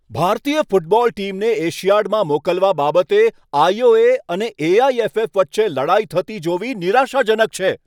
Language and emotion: Gujarati, angry